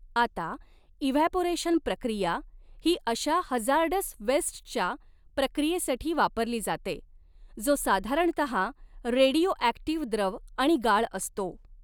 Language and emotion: Marathi, neutral